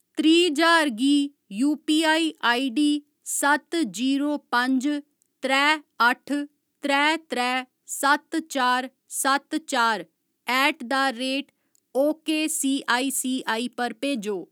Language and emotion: Dogri, neutral